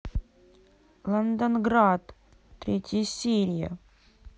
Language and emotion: Russian, angry